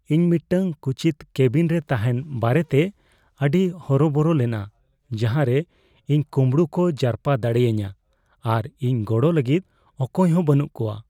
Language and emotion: Santali, fearful